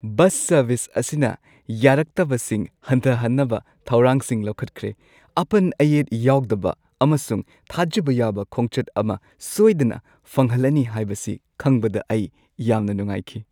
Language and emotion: Manipuri, happy